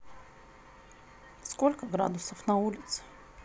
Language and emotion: Russian, neutral